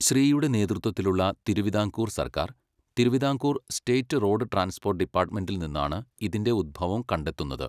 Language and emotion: Malayalam, neutral